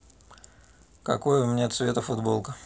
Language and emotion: Russian, neutral